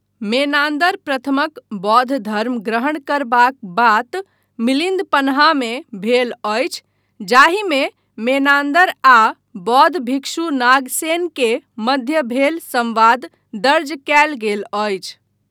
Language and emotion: Maithili, neutral